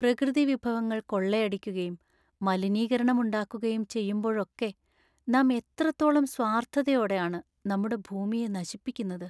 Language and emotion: Malayalam, sad